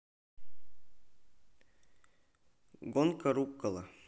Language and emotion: Russian, neutral